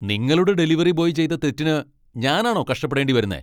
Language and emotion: Malayalam, angry